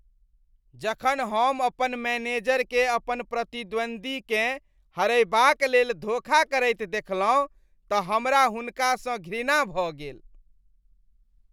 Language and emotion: Maithili, disgusted